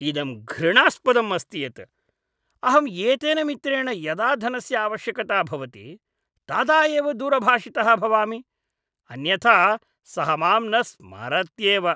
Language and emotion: Sanskrit, disgusted